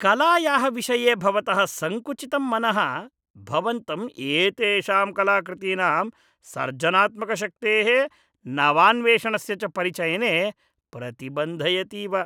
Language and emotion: Sanskrit, disgusted